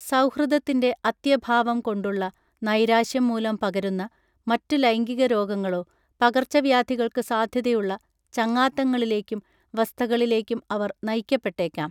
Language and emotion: Malayalam, neutral